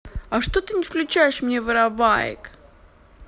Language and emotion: Russian, neutral